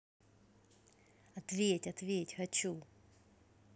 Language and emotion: Russian, neutral